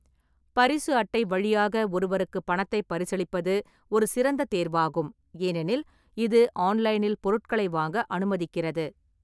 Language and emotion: Tamil, neutral